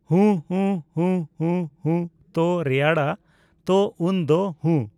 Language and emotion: Santali, neutral